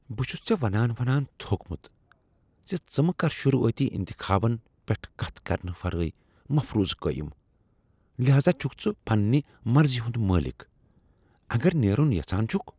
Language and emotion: Kashmiri, disgusted